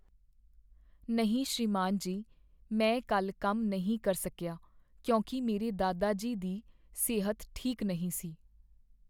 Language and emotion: Punjabi, sad